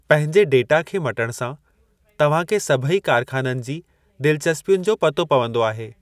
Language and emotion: Sindhi, neutral